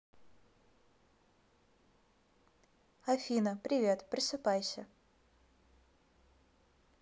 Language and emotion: Russian, neutral